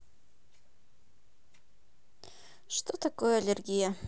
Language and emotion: Russian, neutral